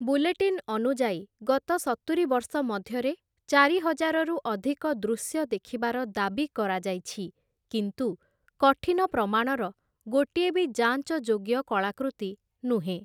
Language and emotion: Odia, neutral